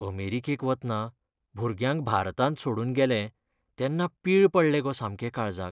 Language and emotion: Goan Konkani, sad